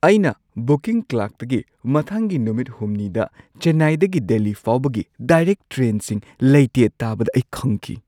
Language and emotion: Manipuri, surprised